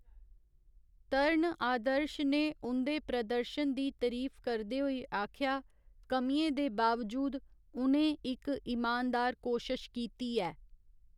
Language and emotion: Dogri, neutral